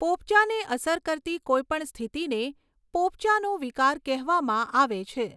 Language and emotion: Gujarati, neutral